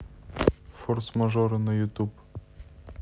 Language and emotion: Russian, neutral